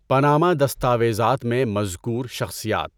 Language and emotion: Urdu, neutral